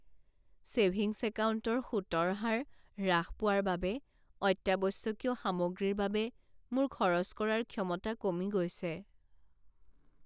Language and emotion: Assamese, sad